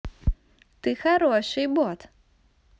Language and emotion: Russian, positive